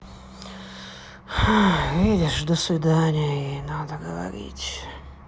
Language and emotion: Russian, sad